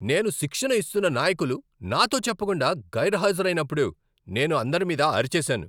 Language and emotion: Telugu, angry